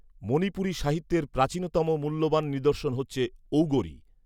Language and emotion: Bengali, neutral